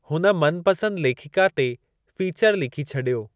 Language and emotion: Sindhi, neutral